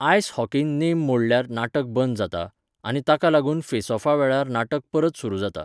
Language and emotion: Goan Konkani, neutral